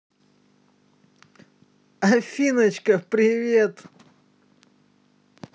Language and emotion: Russian, positive